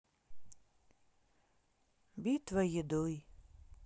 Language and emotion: Russian, sad